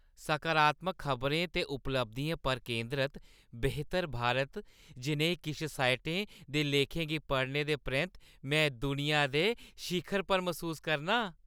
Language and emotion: Dogri, happy